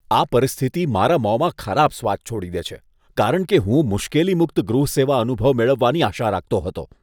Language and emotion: Gujarati, disgusted